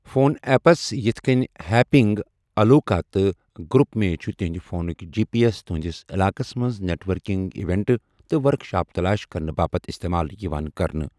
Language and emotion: Kashmiri, neutral